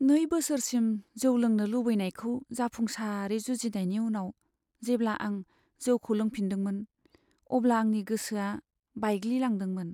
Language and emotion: Bodo, sad